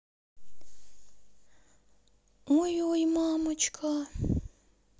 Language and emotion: Russian, neutral